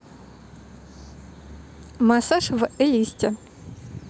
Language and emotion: Russian, neutral